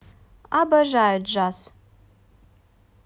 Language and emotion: Russian, positive